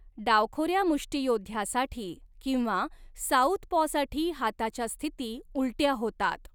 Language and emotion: Marathi, neutral